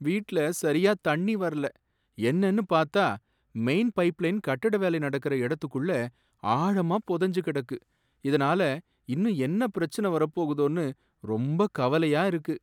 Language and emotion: Tamil, sad